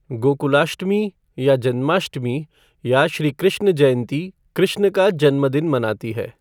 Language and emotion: Hindi, neutral